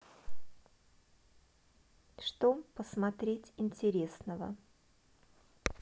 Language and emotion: Russian, neutral